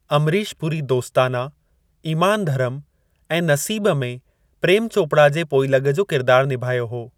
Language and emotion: Sindhi, neutral